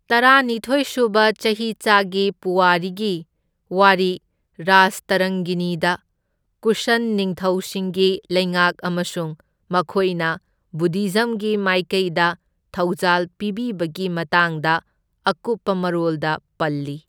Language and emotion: Manipuri, neutral